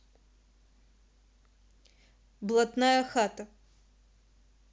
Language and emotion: Russian, neutral